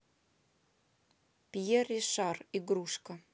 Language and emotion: Russian, neutral